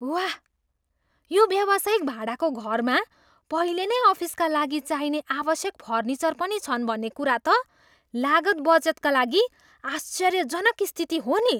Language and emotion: Nepali, surprised